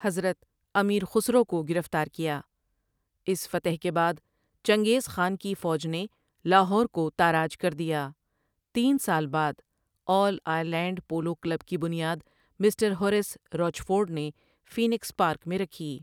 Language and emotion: Urdu, neutral